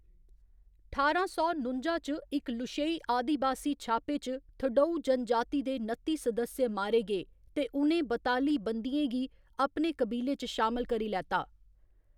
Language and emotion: Dogri, neutral